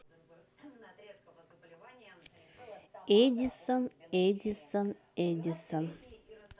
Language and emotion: Russian, neutral